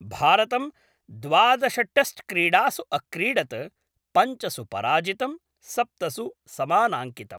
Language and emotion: Sanskrit, neutral